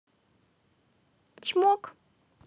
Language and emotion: Russian, positive